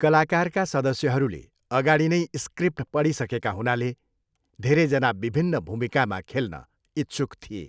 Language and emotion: Nepali, neutral